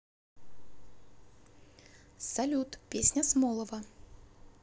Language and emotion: Russian, positive